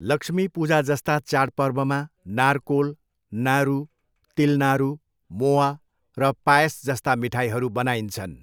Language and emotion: Nepali, neutral